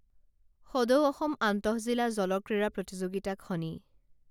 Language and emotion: Assamese, neutral